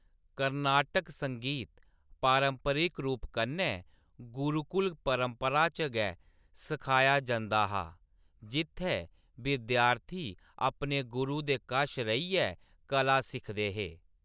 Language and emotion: Dogri, neutral